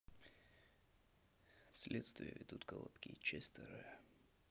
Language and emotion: Russian, neutral